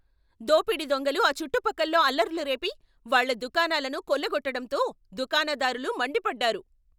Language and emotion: Telugu, angry